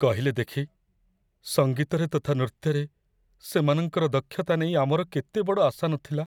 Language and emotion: Odia, sad